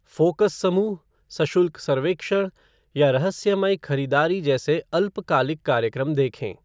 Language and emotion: Hindi, neutral